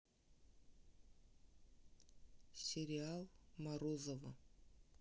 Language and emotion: Russian, neutral